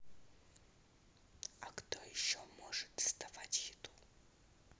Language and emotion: Russian, neutral